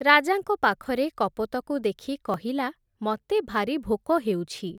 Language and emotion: Odia, neutral